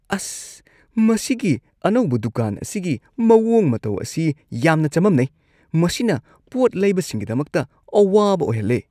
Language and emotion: Manipuri, disgusted